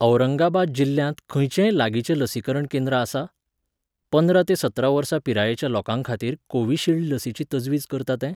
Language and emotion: Goan Konkani, neutral